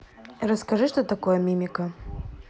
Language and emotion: Russian, neutral